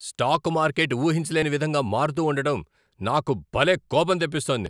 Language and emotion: Telugu, angry